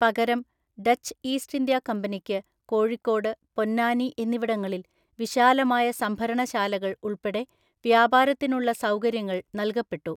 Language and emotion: Malayalam, neutral